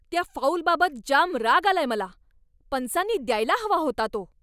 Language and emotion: Marathi, angry